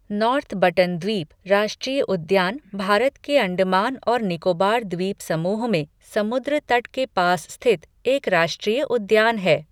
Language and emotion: Hindi, neutral